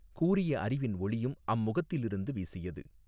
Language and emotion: Tamil, neutral